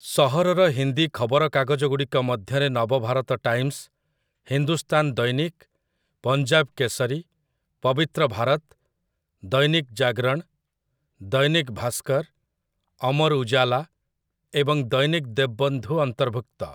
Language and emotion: Odia, neutral